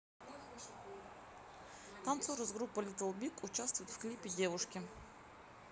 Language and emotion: Russian, neutral